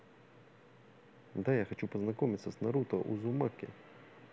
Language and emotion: Russian, neutral